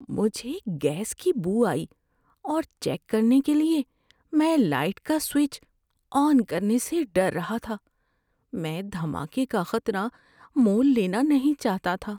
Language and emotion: Urdu, fearful